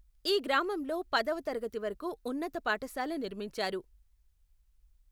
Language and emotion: Telugu, neutral